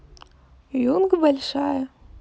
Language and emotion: Russian, neutral